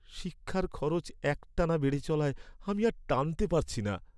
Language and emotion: Bengali, sad